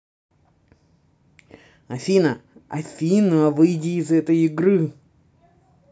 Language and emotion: Russian, angry